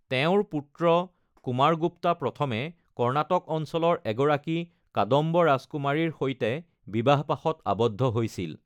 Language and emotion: Assamese, neutral